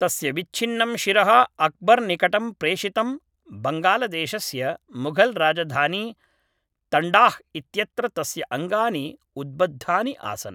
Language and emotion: Sanskrit, neutral